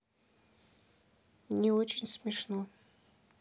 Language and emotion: Russian, sad